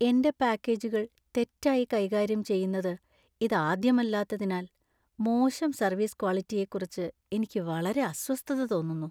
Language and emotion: Malayalam, sad